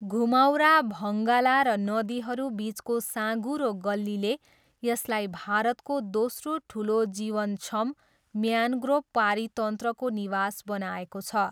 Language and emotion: Nepali, neutral